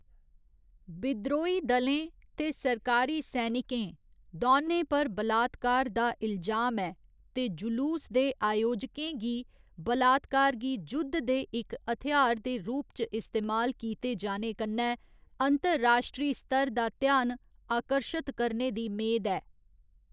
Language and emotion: Dogri, neutral